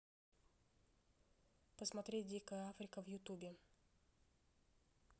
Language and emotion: Russian, neutral